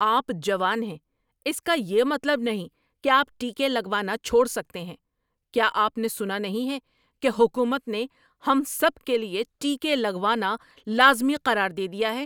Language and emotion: Urdu, angry